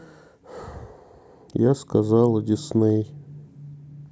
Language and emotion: Russian, sad